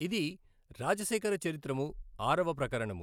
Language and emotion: Telugu, neutral